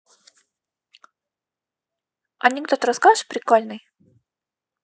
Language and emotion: Russian, positive